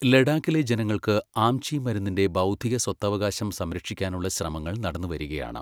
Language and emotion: Malayalam, neutral